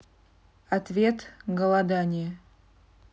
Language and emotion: Russian, neutral